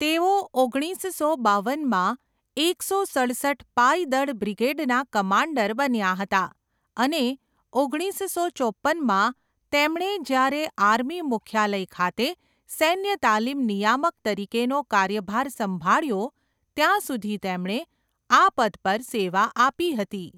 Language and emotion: Gujarati, neutral